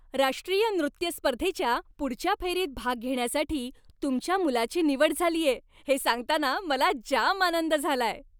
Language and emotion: Marathi, happy